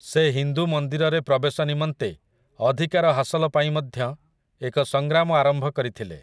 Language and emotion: Odia, neutral